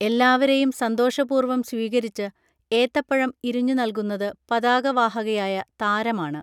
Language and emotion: Malayalam, neutral